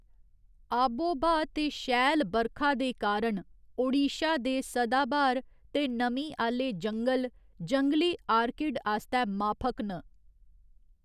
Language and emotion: Dogri, neutral